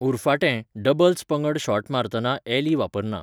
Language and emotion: Goan Konkani, neutral